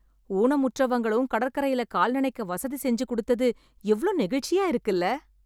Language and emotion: Tamil, happy